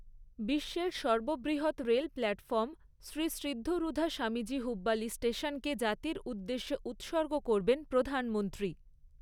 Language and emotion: Bengali, neutral